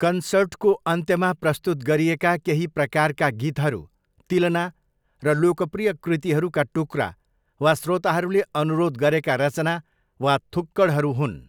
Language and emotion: Nepali, neutral